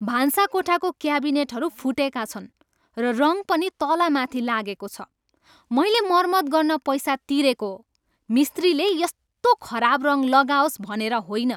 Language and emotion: Nepali, angry